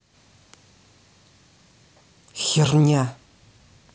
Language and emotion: Russian, angry